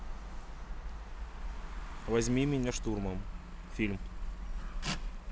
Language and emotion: Russian, neutral